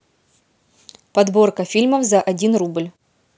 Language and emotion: Russian, neutral